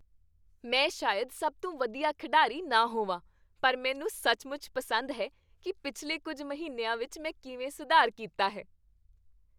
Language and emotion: Punjabi, happy